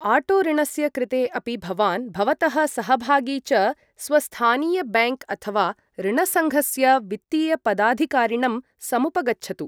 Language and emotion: Sanskrit, neutral